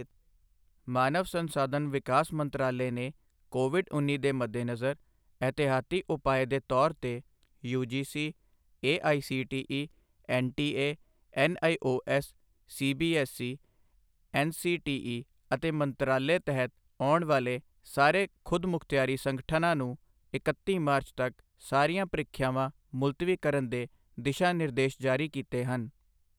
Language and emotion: Punjabi, neutral